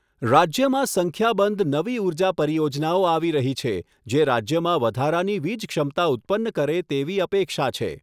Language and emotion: Gujarati, neutral